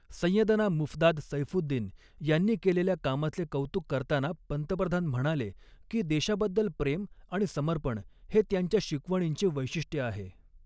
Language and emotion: Marathi, neutral